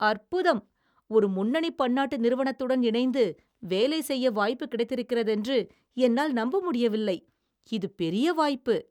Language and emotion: Tamil, surprised